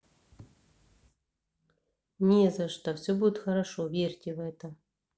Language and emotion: Russian, neutral